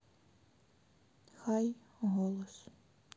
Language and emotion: Russian, sad